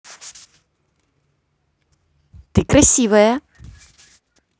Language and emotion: Russian, positive